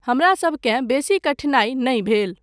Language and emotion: Maithili, neutral